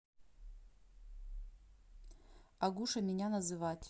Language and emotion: Russian, neutral